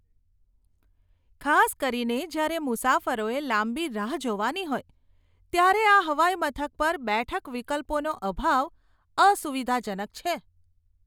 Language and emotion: Gujarati, disgusted